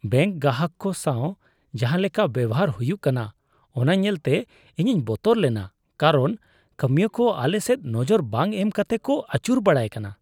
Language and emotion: Santali, disgusted